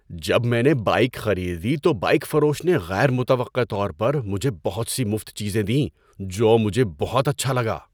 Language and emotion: Urdu, surprised